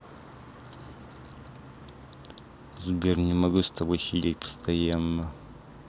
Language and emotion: Russian, neutral